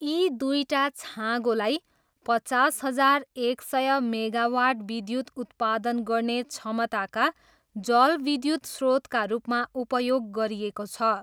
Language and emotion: Nepali, neutral